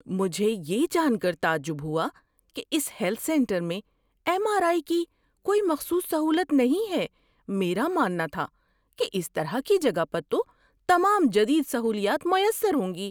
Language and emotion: Urdu, surprised